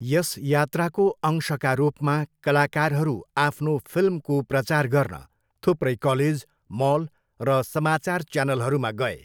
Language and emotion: Nepali, neutral